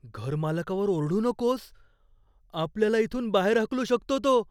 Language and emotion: Marathi, fearful